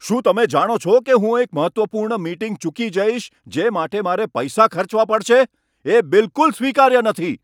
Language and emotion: Gujarati, angry